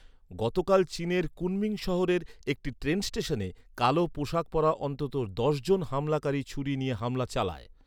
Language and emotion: Bengali, neutral